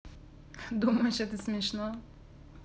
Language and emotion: Russian, positive